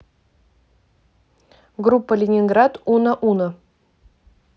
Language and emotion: Russian, neutral